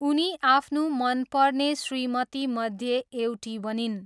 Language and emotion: Nepali, neutral